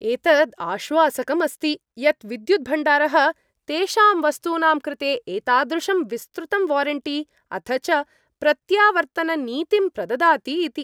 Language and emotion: Sanskrit, happy